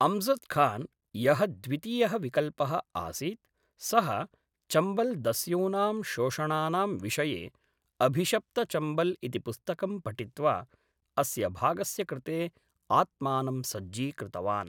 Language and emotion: Sanskrit, neutral